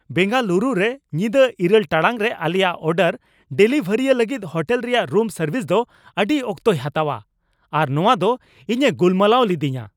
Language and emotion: Santali, angry